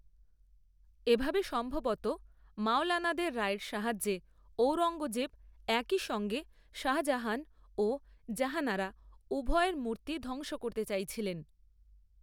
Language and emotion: Bengali, neutral